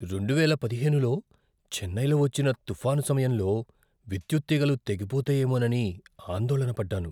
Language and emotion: Telugu, fearful